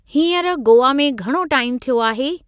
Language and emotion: Sindhi, neutral